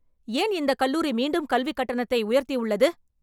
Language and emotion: Tamil, angry